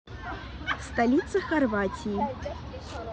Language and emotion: Russian, neutral